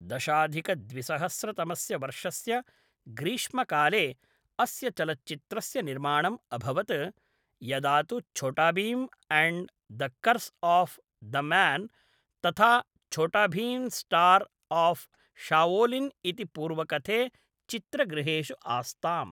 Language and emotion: Sanskrit, neutral